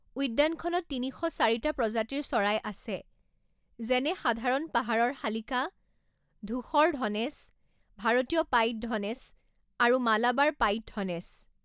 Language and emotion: Assamese, neutral